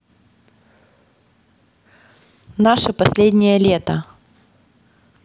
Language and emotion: Russian, neutral